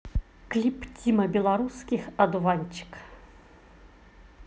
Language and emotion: Russian, positive